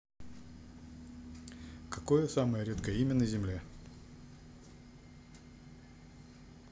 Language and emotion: Russian, neutral